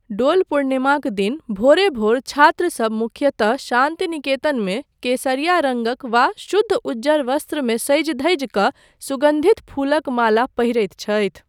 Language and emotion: Maithili, neutral